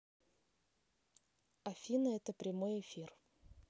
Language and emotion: Russian, neutral